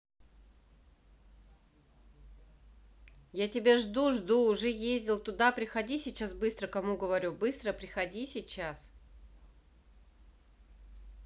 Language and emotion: Russian, neutral